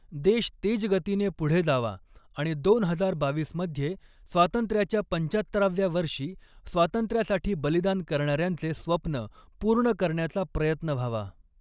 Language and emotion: Marathi, neutral